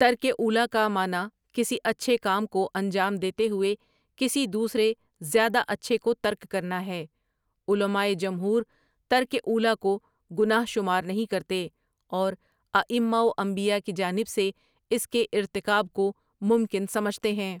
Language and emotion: Urdu, neutral